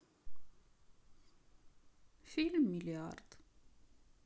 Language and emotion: Russian, neutral